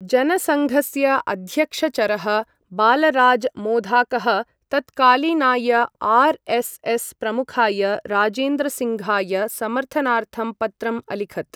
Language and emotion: Sanskrit, neutral